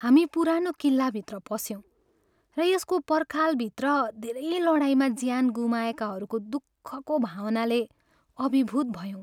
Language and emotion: Nepali, sad